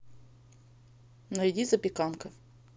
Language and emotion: Russian, neutral